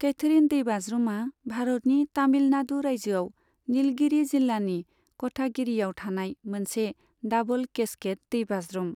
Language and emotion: Bodo, neutral